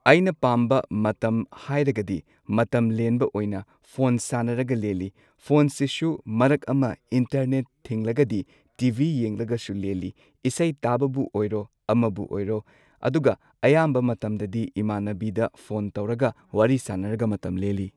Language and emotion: Manipuri, neutral